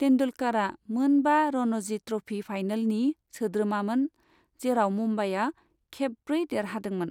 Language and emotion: Bodo, neutral